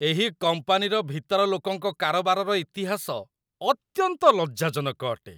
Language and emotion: Odia, disgusted